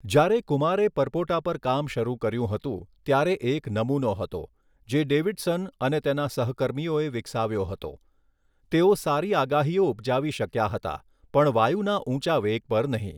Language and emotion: Gujarati, neutral